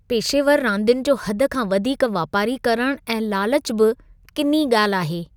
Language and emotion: Sindhi, disgusted